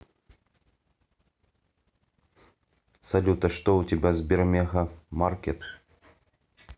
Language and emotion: Russian, neutral